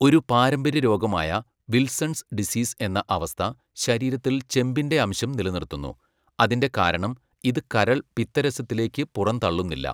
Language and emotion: Malayalam, neutral